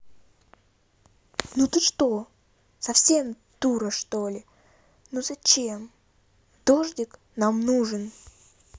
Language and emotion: Russian, angry